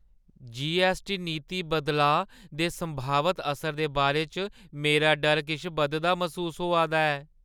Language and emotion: Dogri, fearful